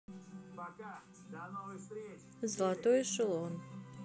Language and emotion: Russian, neutral